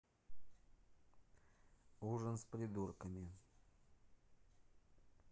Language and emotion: Russian, neutral